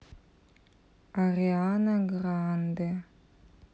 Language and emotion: Russian, neutral